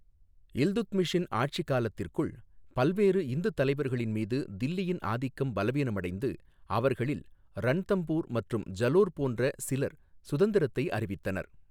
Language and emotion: Tamil, neutral